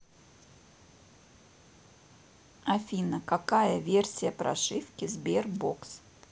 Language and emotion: Russian, neutral